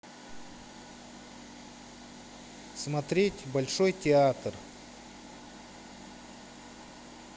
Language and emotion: Russian, neutral